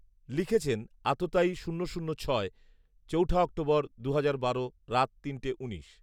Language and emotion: Bengali, neutral